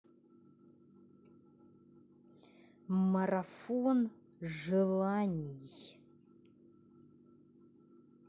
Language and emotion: Russian, angry